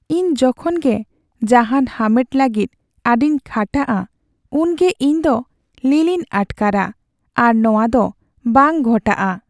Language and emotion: Santali, sad